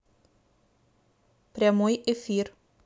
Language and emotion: Russian, neutral